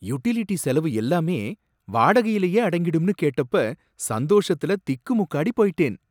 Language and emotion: Tamil, surprised